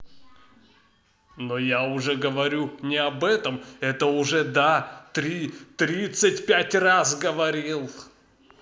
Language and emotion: Russian, angry